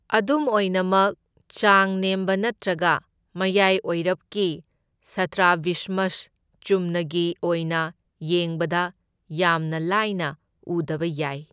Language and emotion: Manipuri, neutral